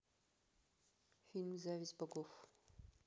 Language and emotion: Russian, neutral